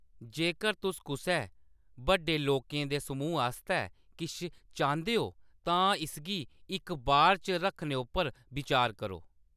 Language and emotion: Dogri, neutral